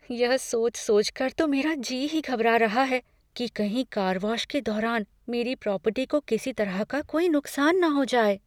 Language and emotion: Hindi, fearful